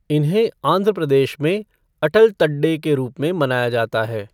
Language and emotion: Hindi, neutral